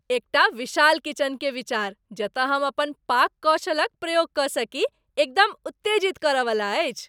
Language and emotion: Maithili, happy